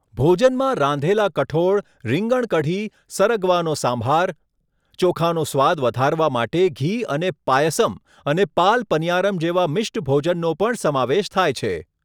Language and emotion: Gujarati, neutral